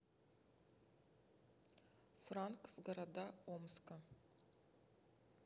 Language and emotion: Russian, neutral